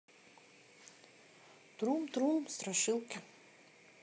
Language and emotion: Russian, neutral